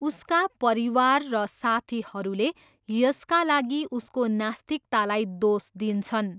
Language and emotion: Nepali, neutral